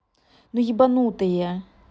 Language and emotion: Russian, angry